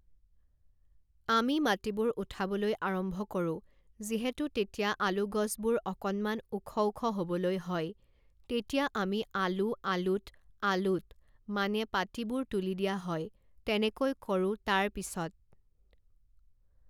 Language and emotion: Assamese, neutral